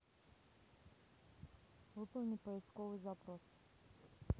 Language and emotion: Russian, neutral